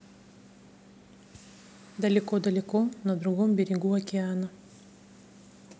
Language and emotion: Russian, neutral